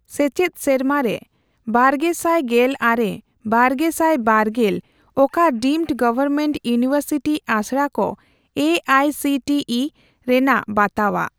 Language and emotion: Santali, neutral